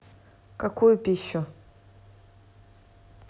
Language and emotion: Russian, neutral